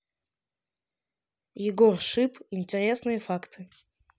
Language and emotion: Russian, neutral